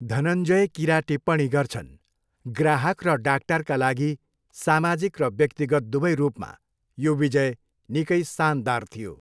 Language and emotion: Nepali, neutral